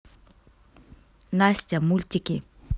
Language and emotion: Russian, neutral